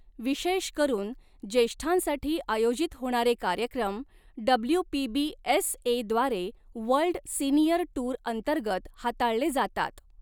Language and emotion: Marathi, neutral